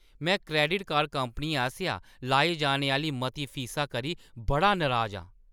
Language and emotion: Dogri, angry